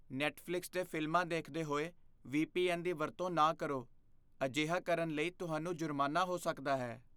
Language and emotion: Punjabi, fearful